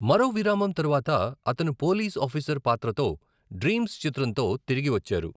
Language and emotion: Telugu, neutral